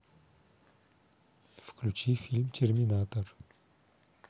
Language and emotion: Russian, neutral